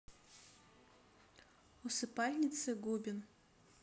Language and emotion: Russian, neutral